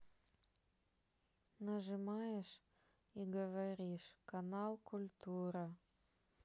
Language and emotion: Russian, sad